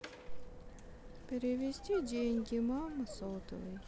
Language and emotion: Russian, sad